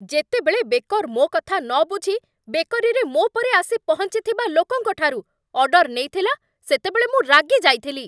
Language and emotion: Odia, angry